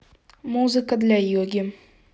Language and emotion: Russian, neutral